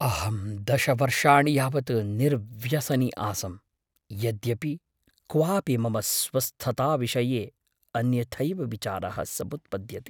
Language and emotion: Sanskrit, fearful